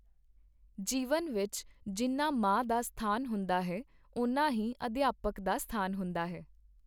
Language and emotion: Punjabi, neutral